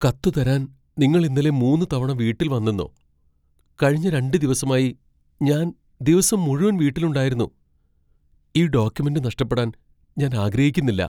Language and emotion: Malayalam, fearful